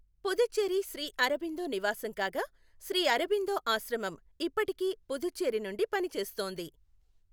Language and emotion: Telugu, neutral